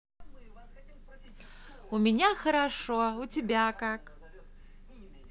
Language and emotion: Russian, positive